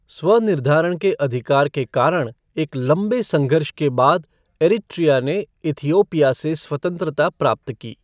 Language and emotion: Hindi, neutral